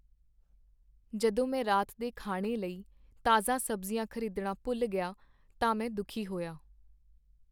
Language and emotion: Punjabi, sad